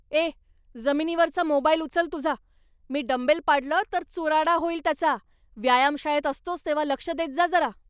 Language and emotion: Marathi, angry